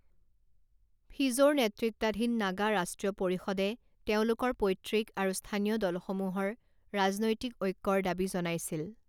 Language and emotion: Assamese, neutral